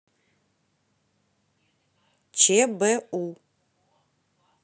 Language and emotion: Russian, neutral